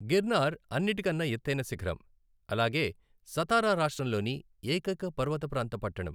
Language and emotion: Telugu, neutral